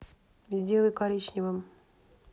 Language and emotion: Russian, neutral